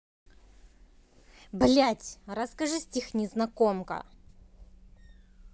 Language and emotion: Russian, angry